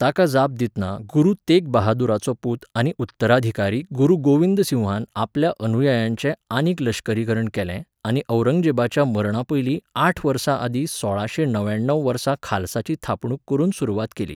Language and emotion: Goan Konkani, neutral